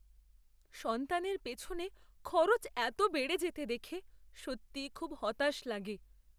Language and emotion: Bengali, sad